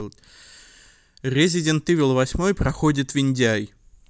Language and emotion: Russian, neutral